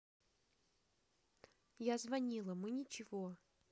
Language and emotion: Russian, neutral